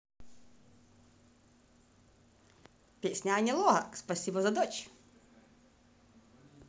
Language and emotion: Russian, positive